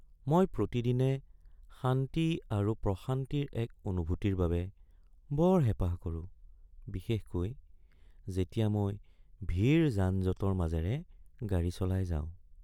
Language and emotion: Assamese, sad